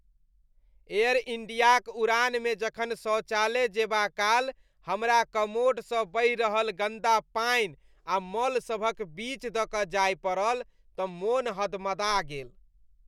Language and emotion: Maithili, disgusted